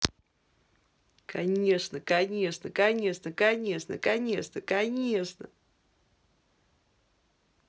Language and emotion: Russian, positive